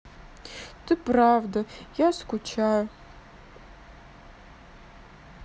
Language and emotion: Russian, sad